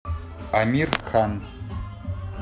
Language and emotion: Russian, neutral